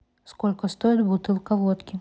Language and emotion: Russian, neutral